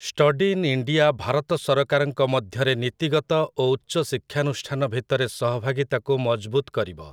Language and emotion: Odia, neutral